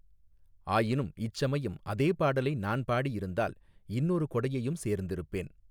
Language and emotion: Tamil, neutral